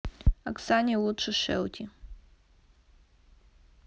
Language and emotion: Russian, neutral